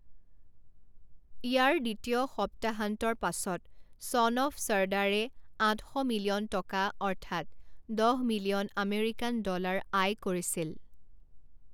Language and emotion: Assamese, neutral